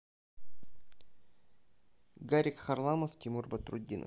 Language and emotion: Russian, neutral